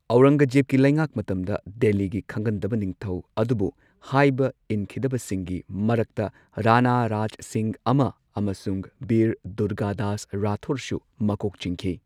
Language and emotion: Manipuri, neutral